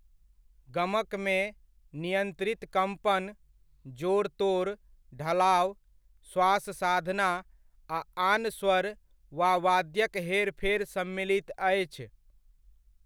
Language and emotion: Maithili, neutral